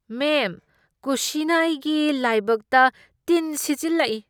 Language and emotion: Manipuri, disgusted